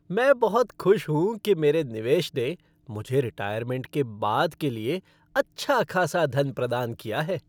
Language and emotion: Hindi, happy